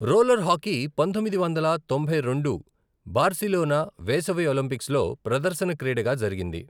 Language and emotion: Telugu, neutral